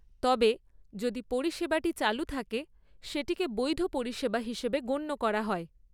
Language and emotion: Bengali, neutral